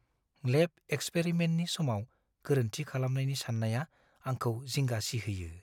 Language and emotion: Bodo, fearful